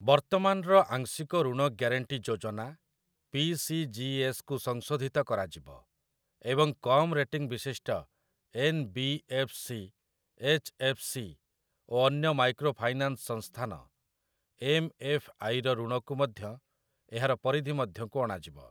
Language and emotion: Odia, neutral